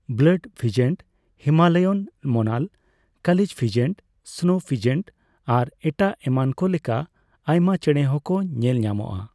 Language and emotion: Santali, neutral